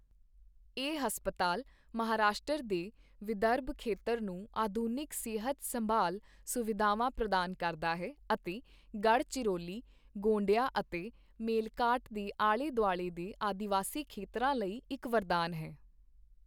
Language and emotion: Punjabi, neutral